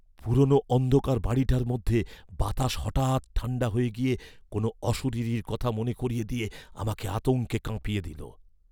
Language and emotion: Bengali, fearful